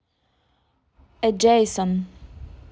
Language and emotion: Russian, neutral